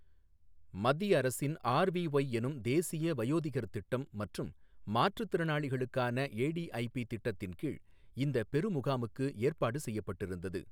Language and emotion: Tamil, neutral